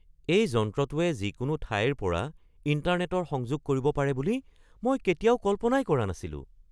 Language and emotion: Assamese, surprised